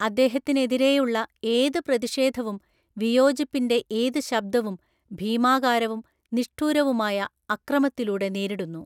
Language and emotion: Malayalam, neutral